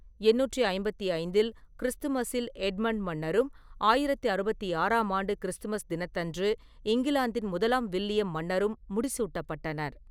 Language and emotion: Tamil, neutral